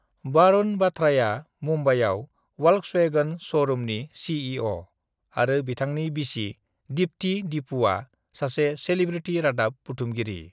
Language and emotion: Bodo, neutral